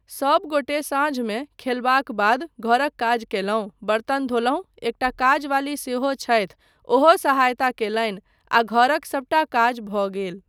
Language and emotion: Maithili, neutral